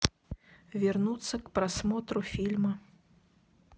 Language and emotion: Russian, neutral